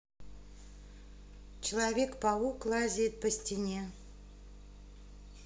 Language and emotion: Russian, neutral